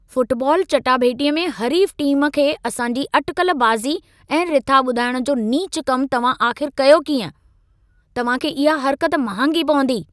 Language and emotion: Sindhi, angry